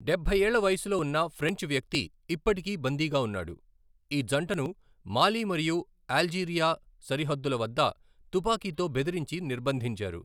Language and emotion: Telugu, neutral